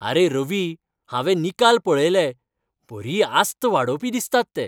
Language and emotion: Goan Konkani, happy